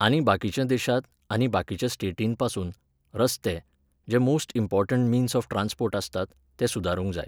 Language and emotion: Goan Konkani, neutral